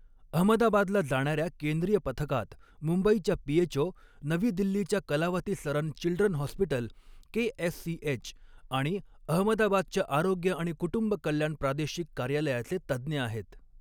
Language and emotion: Marathi, neutral